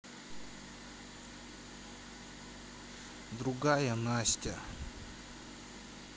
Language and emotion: Russian, neutral